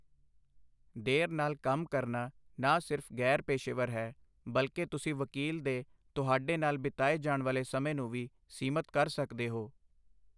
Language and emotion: Punjabi, neutral